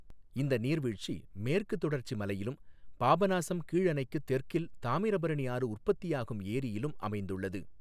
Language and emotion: Tamil, neutral